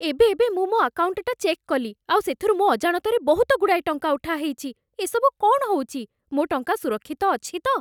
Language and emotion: Odia, fearful